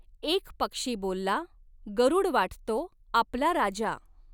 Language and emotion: Marathi, neutral